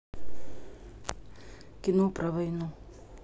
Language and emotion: Russian, neutral